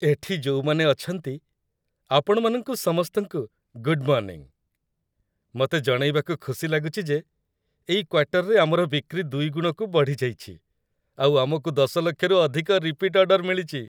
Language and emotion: Odia, happy